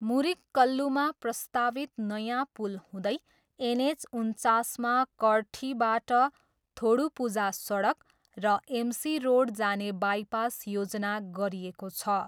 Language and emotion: Nepali, neutral